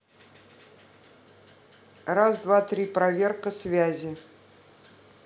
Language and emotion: Russian, neutral